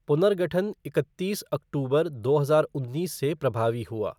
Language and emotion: Hindi, neutral